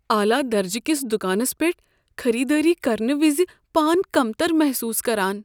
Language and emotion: Kashmiri, fearful